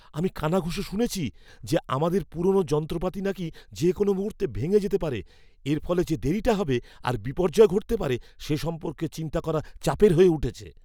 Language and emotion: Bengali, fearful